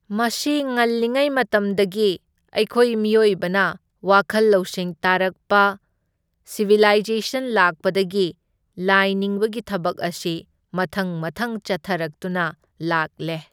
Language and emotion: Manipuri, neutral